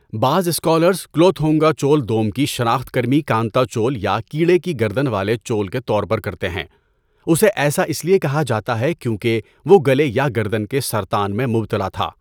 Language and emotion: Urdu, neutral